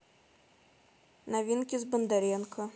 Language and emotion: Russian, neutral